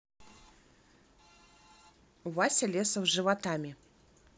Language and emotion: Russian, neutral